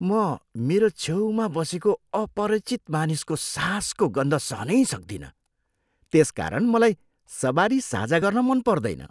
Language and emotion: Nepali, disgusted